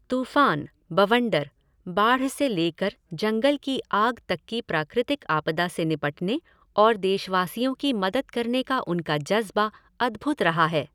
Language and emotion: Hindi, neutral